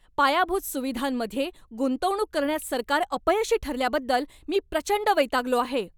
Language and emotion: Marathi, angry